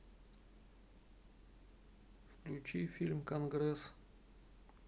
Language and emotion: Russian, neutral